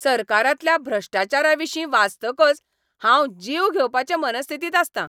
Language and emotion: Goan Konkani, angry